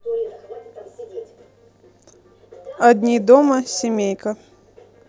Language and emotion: Russian, neutral